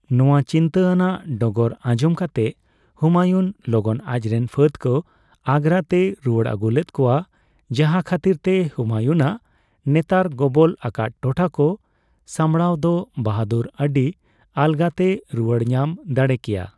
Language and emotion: Santali, neutral